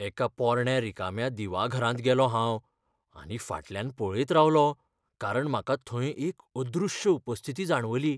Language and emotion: Goan Konkani, fearful